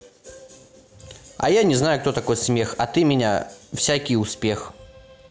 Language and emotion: Russian, neutral